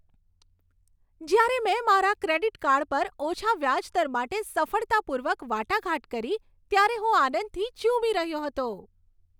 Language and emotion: Gujarati, happy